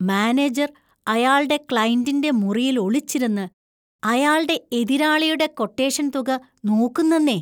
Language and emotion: Malayalam, disgusted